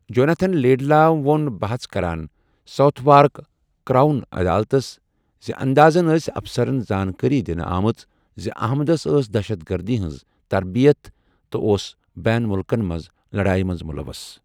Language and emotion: Kashmiri, neutral